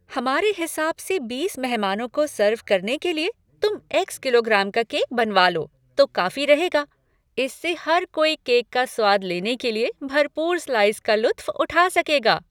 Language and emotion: Hindi, happy